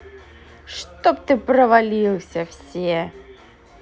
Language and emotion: Russian, angry